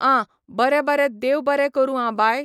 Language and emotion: Goan Konkani, neutral